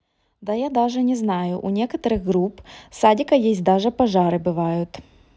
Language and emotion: Russian, neutral